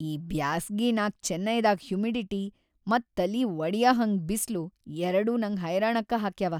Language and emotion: Kannada, sad